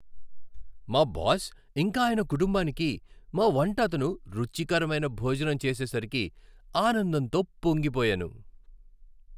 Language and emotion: Telugu, happy